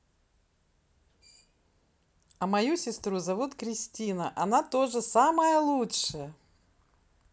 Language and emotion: Russian, positive